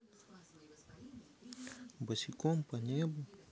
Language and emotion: Russian, sad